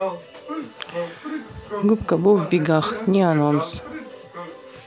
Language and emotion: Russian, neutral